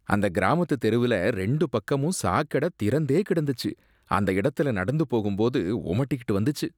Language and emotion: Tamil, disgusted